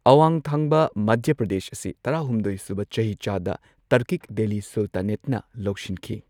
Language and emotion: Manipuri, neutral